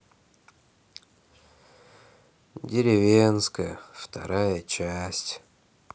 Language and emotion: Russian, sad